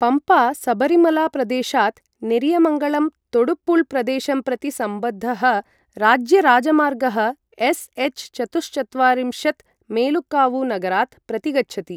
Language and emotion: Sanskrit, neutral